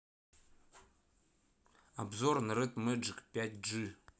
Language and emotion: Russian, neutral